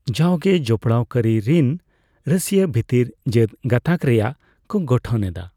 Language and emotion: Santali, neutral